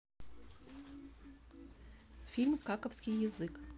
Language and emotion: Russian, neutral